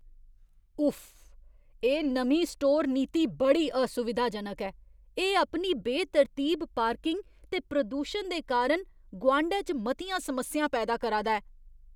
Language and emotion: Dogri, disgusted